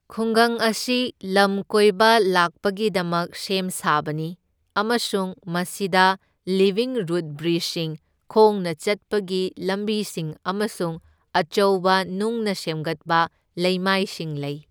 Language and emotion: Manipuri, neutral